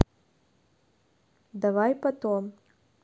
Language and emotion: Russian, neutral